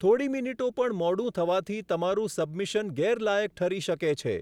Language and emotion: Gujarati, neutral